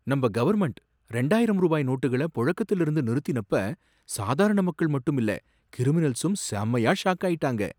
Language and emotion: Tamil, surprised